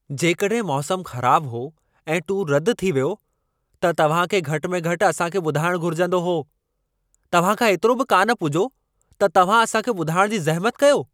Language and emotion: Sindhi, angry